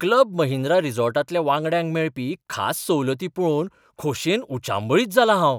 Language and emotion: Goan Konkani, surprised